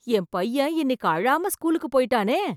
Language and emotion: Tamil, surprised